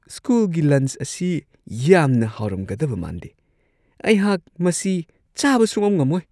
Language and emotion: Manipuri, disgusted